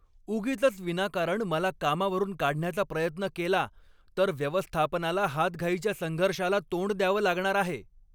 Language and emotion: Marathi, angry